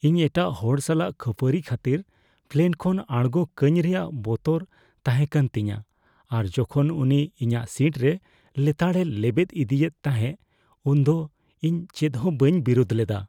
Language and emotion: Santali, fearful